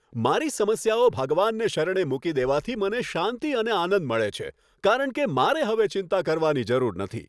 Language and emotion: Gujarati, happy